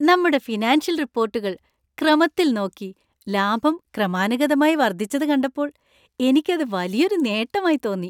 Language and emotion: Malayalam, happy